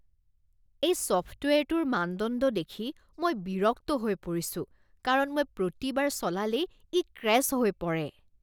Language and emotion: Assamese, disgusted